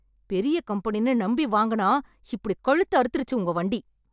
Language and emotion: Tamil, angry